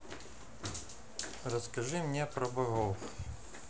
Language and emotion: Russian, neutral